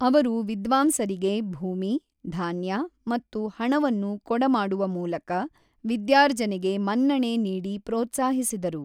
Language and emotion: Kannada, neutral